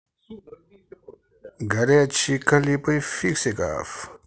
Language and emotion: Russian, positive